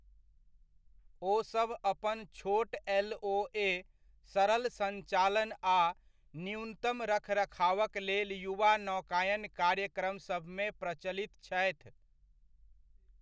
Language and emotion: Maithili, neutral